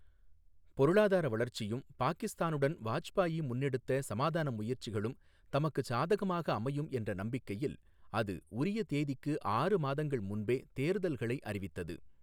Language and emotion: Tamil, neutral